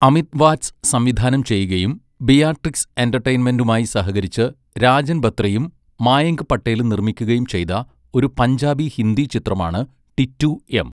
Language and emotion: Malayalam, neutral